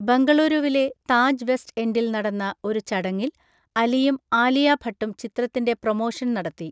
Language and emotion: Malayalam, neutral